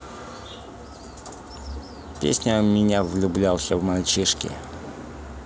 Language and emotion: Russian, neutral